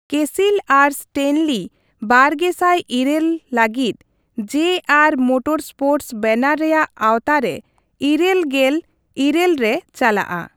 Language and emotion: Santali, neutral